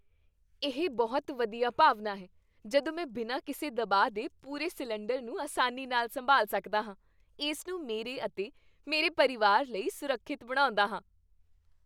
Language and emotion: Punjabi, happy